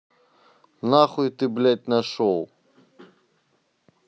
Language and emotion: Russian, angry